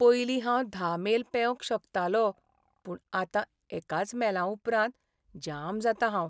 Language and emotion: Goan Konkani, sad